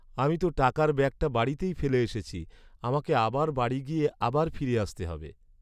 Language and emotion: Bengali, sad